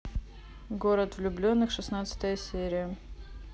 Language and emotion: Russian, neutral